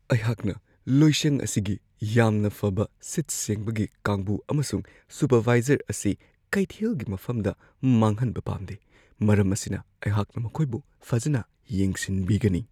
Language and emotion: Manipuri, fearful